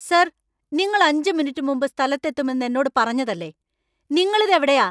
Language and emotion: Malayalam, angry